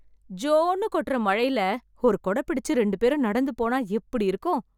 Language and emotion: Tamil, happy